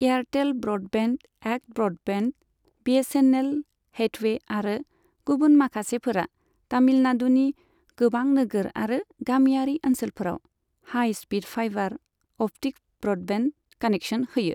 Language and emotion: Bodo, neutral